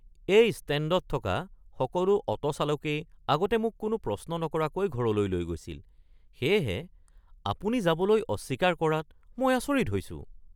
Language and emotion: Assamese, surprised